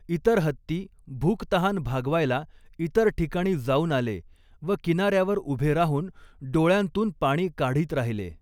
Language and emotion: Marathi, neutral